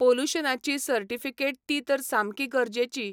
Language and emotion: Goan Konkani, neutral